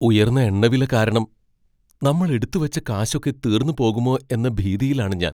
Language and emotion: Malayalam, fearful